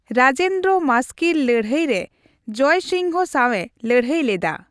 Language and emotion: Santali, neutral